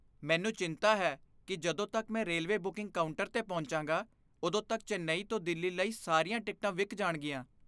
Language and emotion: Punjabi, fearful